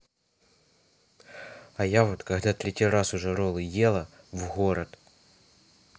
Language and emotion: Russian, neutral